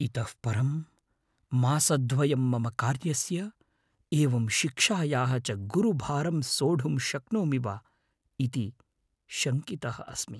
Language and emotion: Sanskrit, fearful